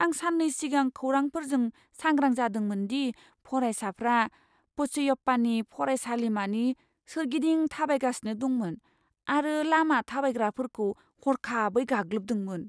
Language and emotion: Bodo, fearful